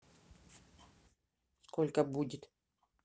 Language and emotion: Russian, neutral